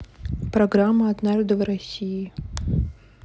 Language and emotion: Russian, neutral